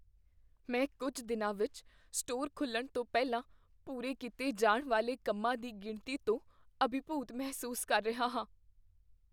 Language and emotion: Punjabi, fearful